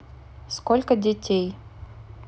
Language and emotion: Russian, neutral